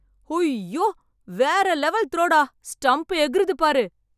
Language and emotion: Tamil, happy